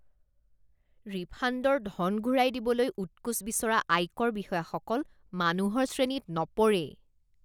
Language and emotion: Assamese, disgusted